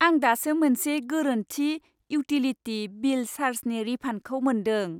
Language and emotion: Bodo, happy